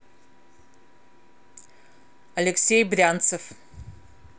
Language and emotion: Russian, neutral